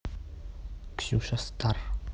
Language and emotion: Russian, neutral